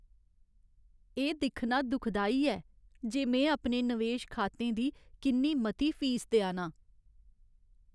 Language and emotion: Dogri, sad